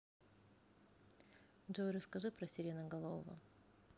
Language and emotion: Russian, neutral